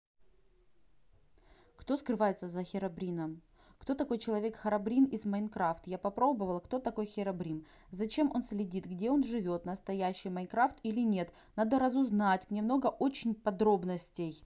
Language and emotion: Russian, neutral